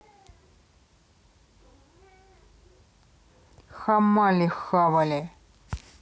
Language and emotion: Russian, neutral